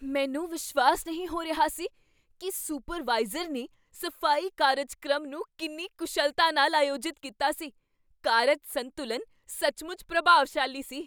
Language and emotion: Punjabi, surprised